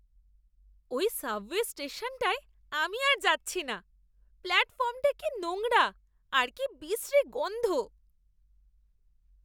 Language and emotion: Bengali, disgusted